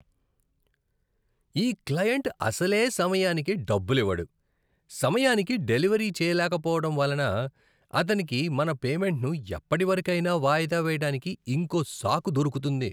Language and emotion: Telugu, disgusted